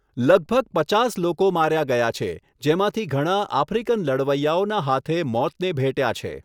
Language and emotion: Gujarati, neutral